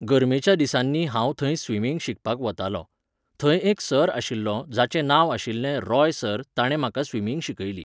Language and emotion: Goan Konkani, neutral